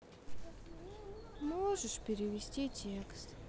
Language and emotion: Russian, sad